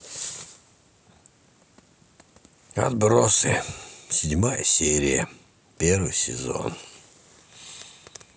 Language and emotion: Russian, sad